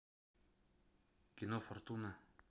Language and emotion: Russian, neutral